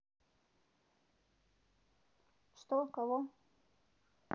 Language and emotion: Russian, neutral